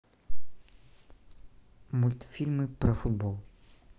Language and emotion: Russian, neutral